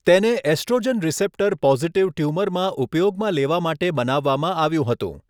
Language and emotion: Gujarati, neutral